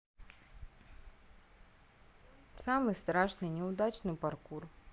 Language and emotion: Russian, neutral